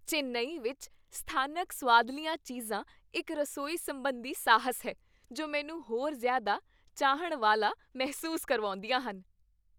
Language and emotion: Punjabi, happy